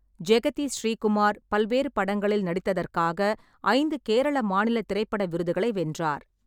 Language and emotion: Tamil, neutral